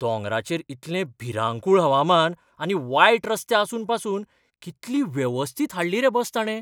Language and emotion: Goan Konkani, surprised